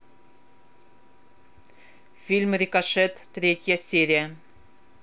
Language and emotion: Russian, neutral